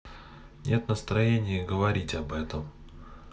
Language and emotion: Russian, sad